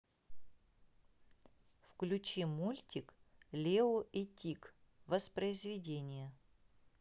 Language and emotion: Russian, neutral